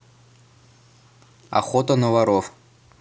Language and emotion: Russian, neutral